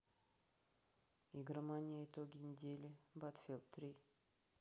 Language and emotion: Russian, neutral